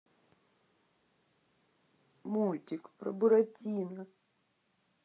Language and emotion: Russian, sad